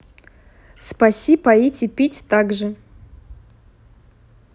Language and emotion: Russian, neutral